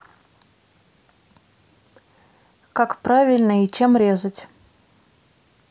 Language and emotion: Russian, neutral